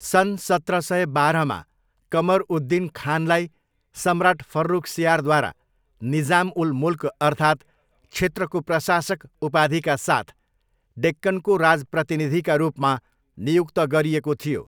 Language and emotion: Nepali, neutral